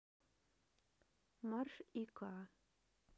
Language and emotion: Russian, neutral